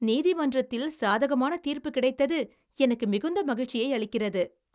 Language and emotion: Tamil, happy